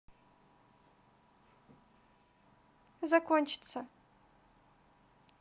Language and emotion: Russian, neutral